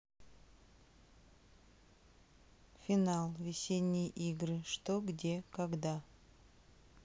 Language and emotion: Russian, neutral